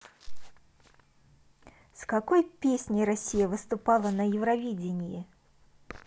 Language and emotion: Russian, neutral